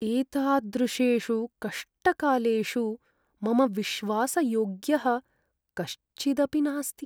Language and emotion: Sanskrit, sad